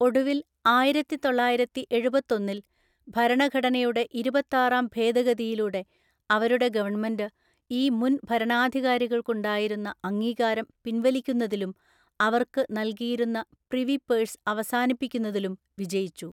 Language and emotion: Malayalam, neutral